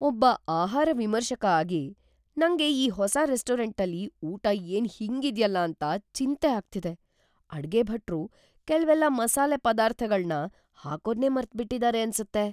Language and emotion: Kannada, fearful